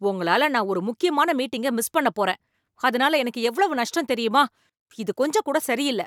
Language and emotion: Tamil, angry